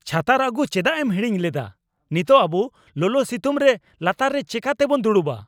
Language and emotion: Santali, angry